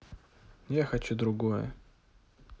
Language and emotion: Russian, neutral